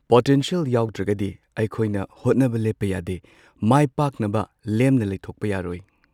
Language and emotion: Manipuri, neutral